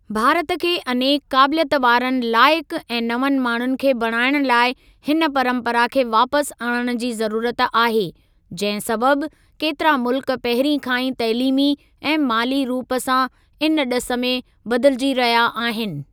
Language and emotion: Sindhi, neutral